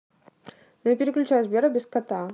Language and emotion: Russian, neutral